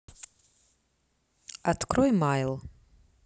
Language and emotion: Russian, neutral